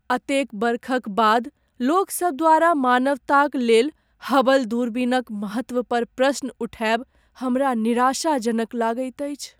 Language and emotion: Maithili, sad